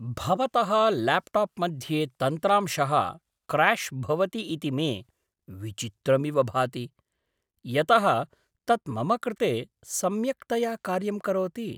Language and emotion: Sanskrit, surprised